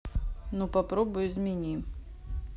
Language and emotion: Russian, neutral